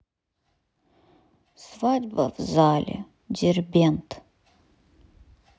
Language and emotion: Russian, sad